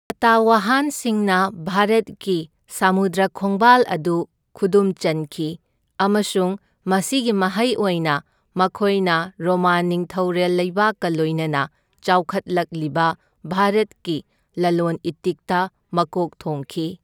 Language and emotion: Manipuri, neutral